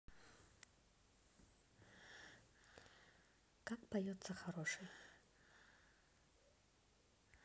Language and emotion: Russian, neutral